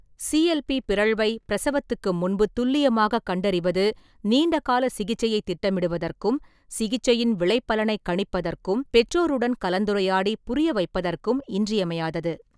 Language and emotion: Tamil, neutral